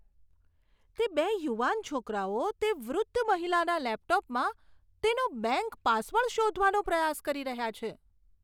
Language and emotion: Gujarati, disgusted